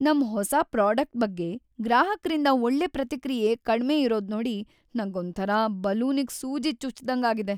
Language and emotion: Kannada, sad